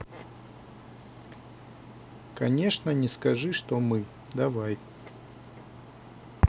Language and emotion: Russian, neutral